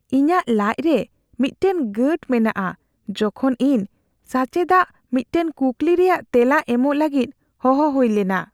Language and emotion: Santali, fearful